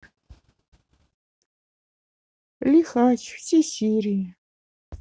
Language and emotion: Russian, sad